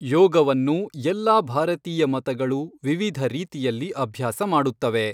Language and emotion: Kannada, neutral